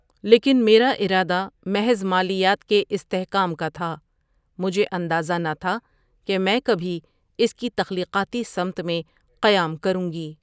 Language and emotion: Urdu, neutral